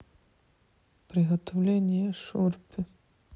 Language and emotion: Russian, neutral